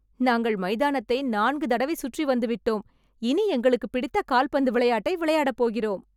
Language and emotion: Tamil, happy